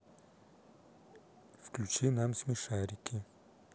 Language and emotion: Russian, neutral